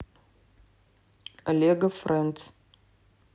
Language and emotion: Russian, neutral